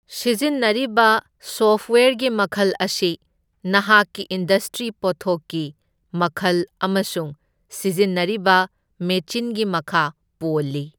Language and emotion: Manipuri, neutral